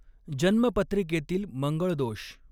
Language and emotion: Marathi, neutral